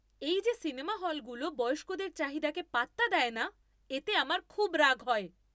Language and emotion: Bengali, angry